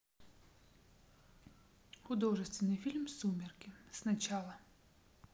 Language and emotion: Russian, neutral